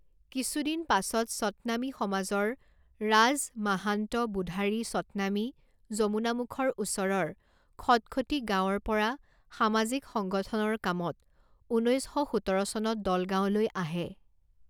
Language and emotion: Assamese, neutral